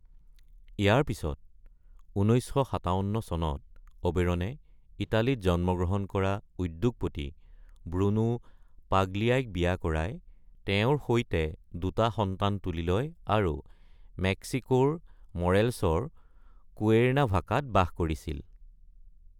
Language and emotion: Assamese, neutral